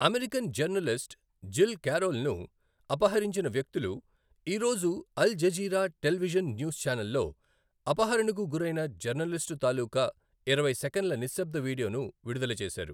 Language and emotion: Telugu, neutral